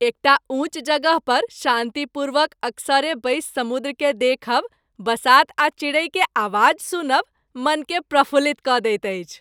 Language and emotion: Maithili, happy